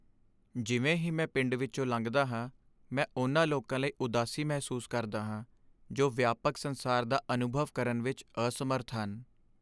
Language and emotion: Punjabi, sad